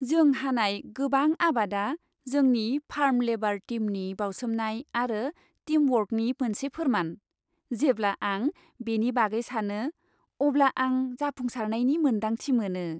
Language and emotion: Bodo, happy